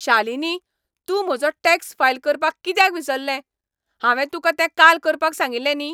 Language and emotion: Goan Konkani, angry